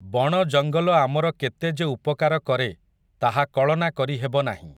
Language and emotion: Odia, neutral